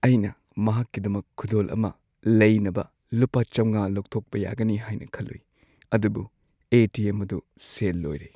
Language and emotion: Manipuri, sad